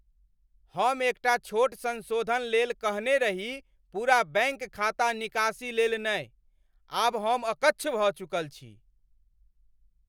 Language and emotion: Maithili, angry